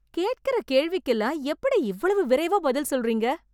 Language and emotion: Tamil, surprised